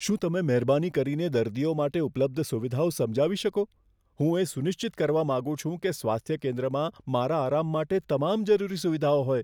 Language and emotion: Gujarati, fearful